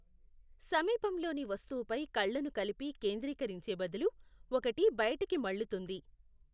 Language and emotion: Telugu, neutral